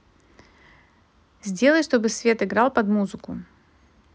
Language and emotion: Russian, neutral